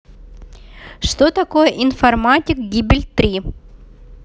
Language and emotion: Russian, neutral